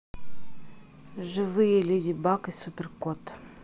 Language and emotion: Russian, neutral